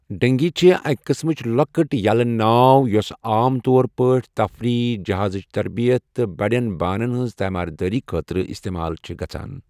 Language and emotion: Kashmiri, neutral